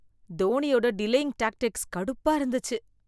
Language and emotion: Tamil, disgusted